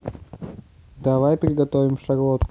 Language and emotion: Russian, neutral